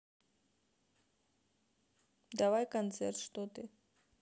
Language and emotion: Russian, neutral